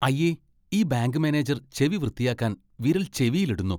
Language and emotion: Malayalam, disgusted